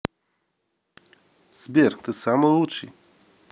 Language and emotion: Russian, positive